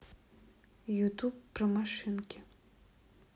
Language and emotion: Russian, neutral